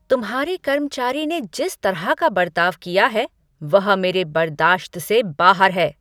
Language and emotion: Hindi, angry